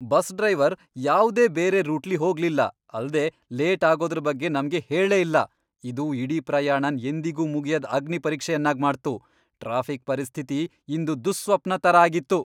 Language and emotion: Kannada, angry